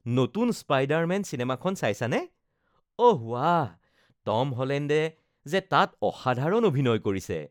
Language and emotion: Assamese, happy